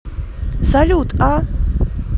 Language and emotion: Russian, positive